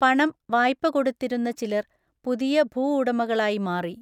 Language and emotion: Malayalam, neutral